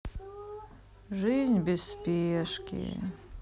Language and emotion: Russian, sad